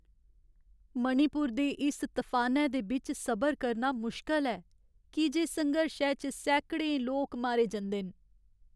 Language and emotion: Dogri, sad